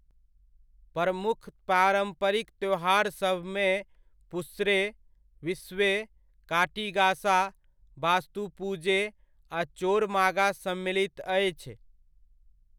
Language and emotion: Maithili, neutral